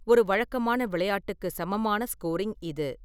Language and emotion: Tamil, neutral